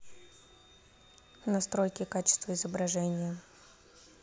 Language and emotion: Russian, neutral